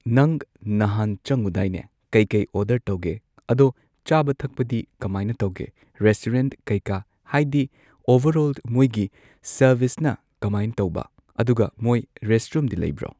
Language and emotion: Manipuri, neutral